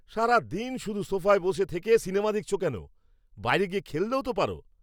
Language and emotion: Bengali, angry